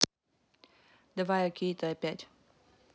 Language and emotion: Russian, neutral